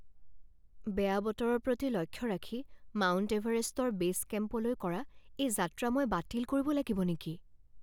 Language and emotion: Assamese, fearful